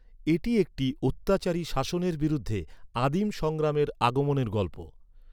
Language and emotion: Bengali, neutral